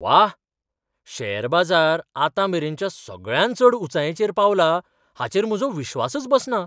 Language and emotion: Goan Konkani, surprised